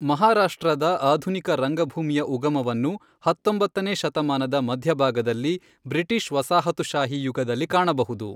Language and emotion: Kannada, neutral